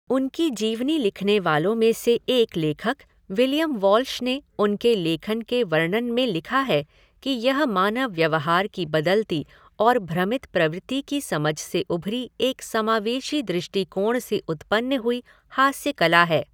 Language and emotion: Hindi, neutral